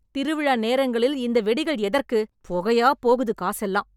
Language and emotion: Tamil, angry